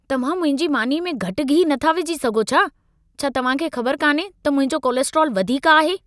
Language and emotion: Sindhi, angry